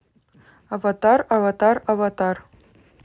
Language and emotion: Russian, neutral